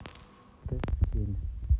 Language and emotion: Russian, neutral